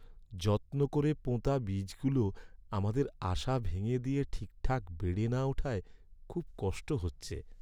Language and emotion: Bengali, sad